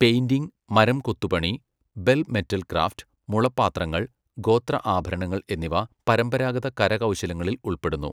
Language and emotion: Malayalam, neutral